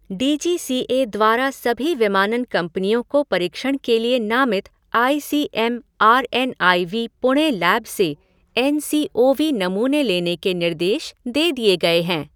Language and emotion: Hindi, neutral